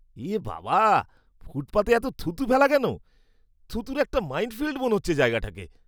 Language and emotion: Bengali, disgusted